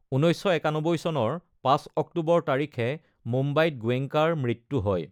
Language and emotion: Assamese, neutral